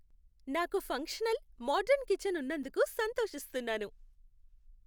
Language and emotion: Telugu, happy